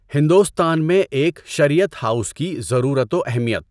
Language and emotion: Urdu, neutral